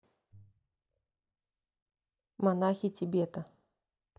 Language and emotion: Russian, neutral